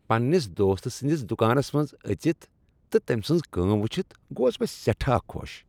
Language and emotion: Kashmiri, happy